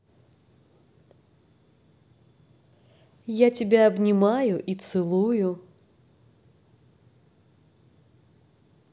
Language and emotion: Russian, positive